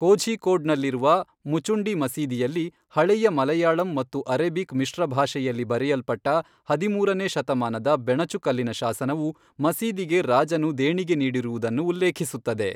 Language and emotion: Kannada, neutral